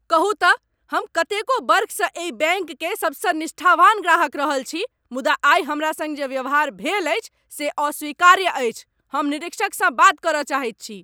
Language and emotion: Maithili, angry